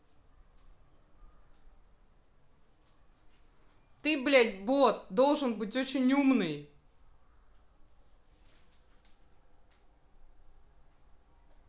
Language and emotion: Russian, angry